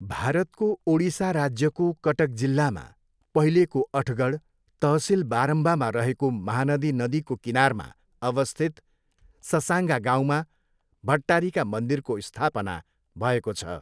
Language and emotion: Nepali, neutral